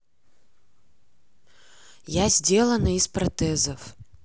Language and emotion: Russian, neutral